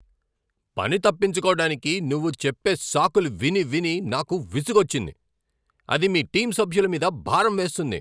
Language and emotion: Telugu, angry